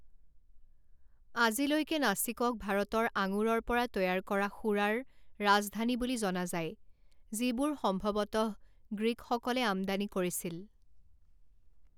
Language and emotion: Assamese, neutral